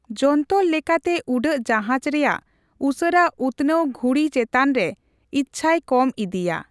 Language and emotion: Santali, neutral